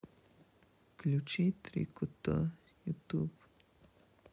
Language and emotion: Russian, sad